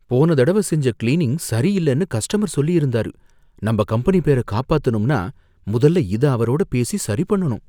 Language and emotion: Tamil, fearful